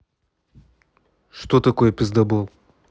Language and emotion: Russian, neutral